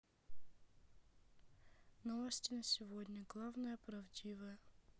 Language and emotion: Russian, sad